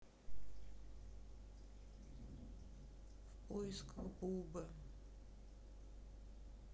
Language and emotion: Russian, sad